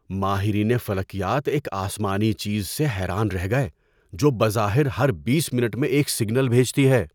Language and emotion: Urdu, surprised